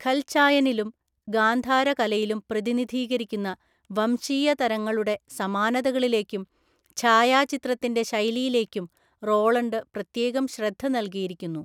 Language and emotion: Malayalam, neutral